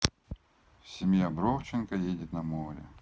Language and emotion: Russian, neutral